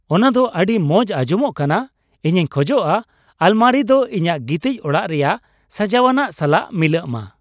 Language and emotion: Santali, happy